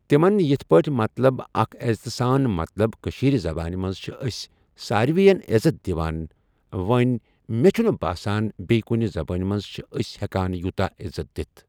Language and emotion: Kashmiri, neutral